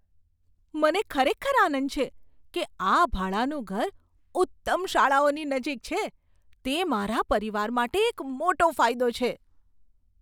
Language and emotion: Gujarati, surprised